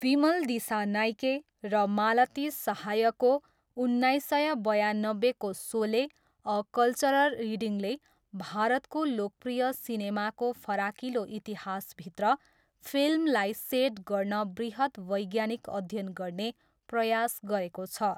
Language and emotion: Nepali, neutral